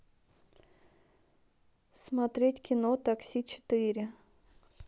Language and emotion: Russian, neutral